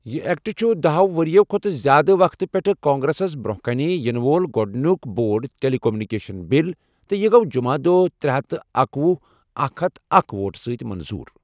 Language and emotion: Kashmiri, neutral